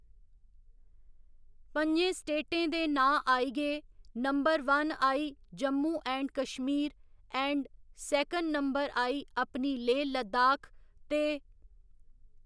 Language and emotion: Dogri, neutral